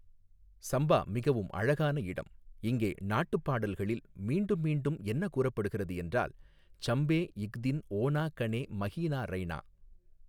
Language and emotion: Tamil, neutral